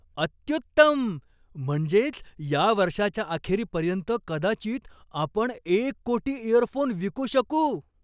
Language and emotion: Marathi, surprised